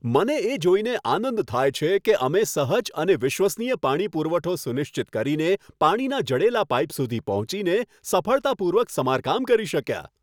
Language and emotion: Gujarati, happy